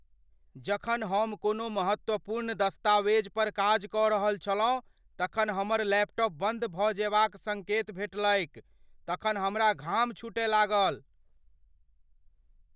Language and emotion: Maithili, fearful